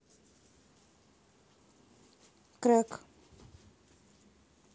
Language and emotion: Russian, neutral